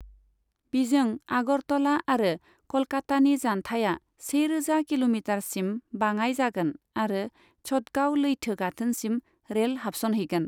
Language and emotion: Bodo, neutral